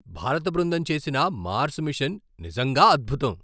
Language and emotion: Telugu, surprised